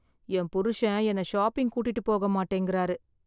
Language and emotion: Tamil, sad